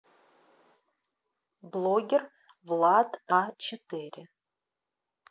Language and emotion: Russian, neutral